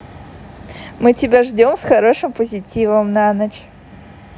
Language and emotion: Russian, positive